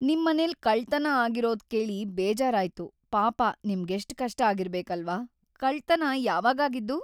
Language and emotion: Kannada, sad